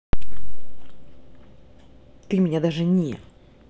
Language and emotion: Russian, angry